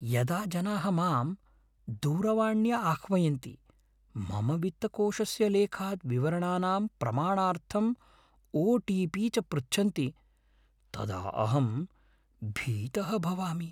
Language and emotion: Sanskrit, fearful